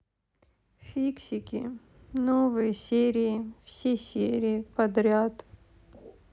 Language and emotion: Russian, sad